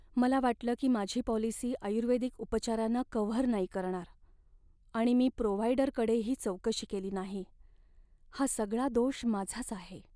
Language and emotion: Marathi, sad